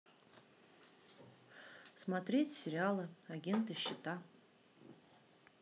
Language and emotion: Russian, neutral